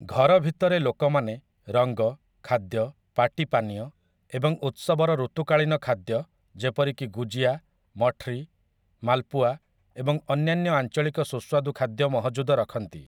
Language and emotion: Odia, neutral